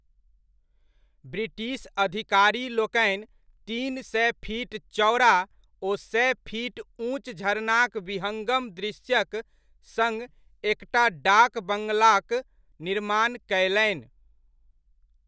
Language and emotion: Maithili, neutral